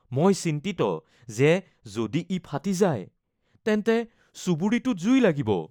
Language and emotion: Assamese, fearful